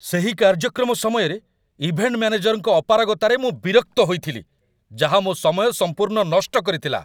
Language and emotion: Odia, angry